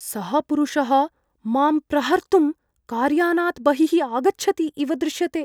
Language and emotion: Sanskrit, fearful